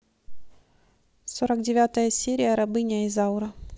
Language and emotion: Russian, neutral